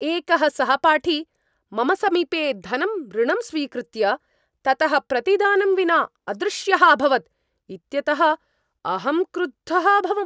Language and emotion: Sanskrit, angry